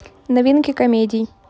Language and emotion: Russian, neutral